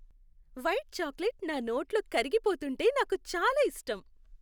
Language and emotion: Telugu, happy